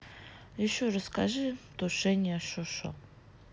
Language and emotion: Russian, neutral